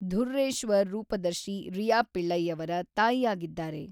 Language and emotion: Kannada, neutral